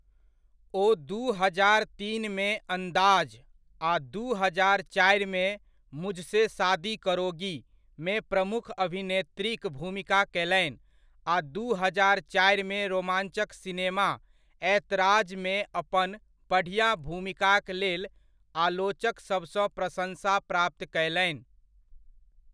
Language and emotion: Maithili, neutral